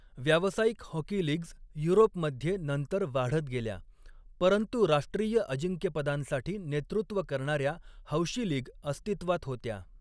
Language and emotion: Marathi, neutral